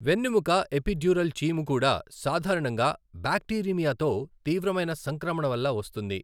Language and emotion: Telugu, neutral